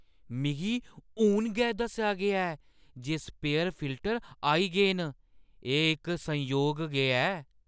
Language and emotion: Dogri, surprised